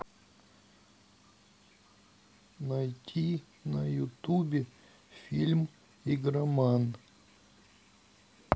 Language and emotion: Russian, neutral